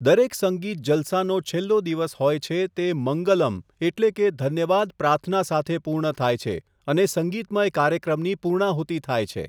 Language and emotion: Gujarati, neutral